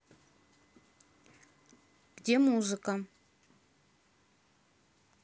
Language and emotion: Russian, neutral